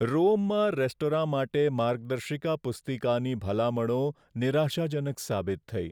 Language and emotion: Gujarati, sad